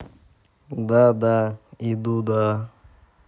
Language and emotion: Russian, neutral